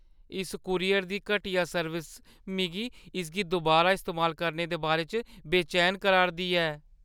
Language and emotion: Dogri, fearful